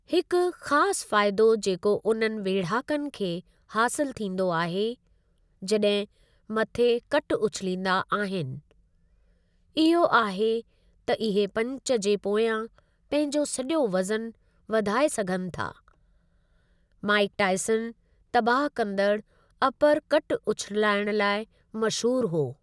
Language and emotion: Sindhi, neutral